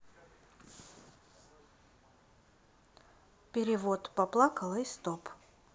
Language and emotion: Russian, neutral